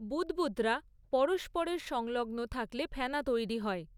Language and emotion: Bengali, neutral